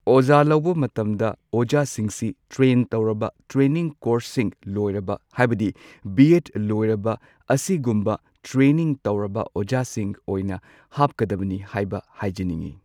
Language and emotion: Manipuri, neutral